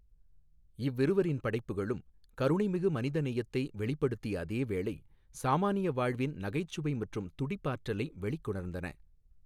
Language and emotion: Tamil, neutral